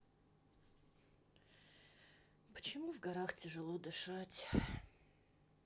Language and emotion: Russian, sad